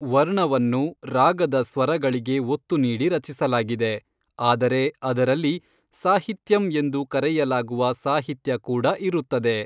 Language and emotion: Kannada, neutral